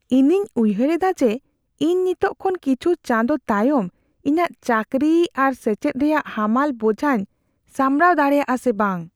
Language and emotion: Santali, fearful